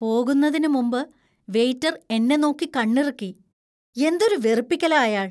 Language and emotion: Malayalam, disgusted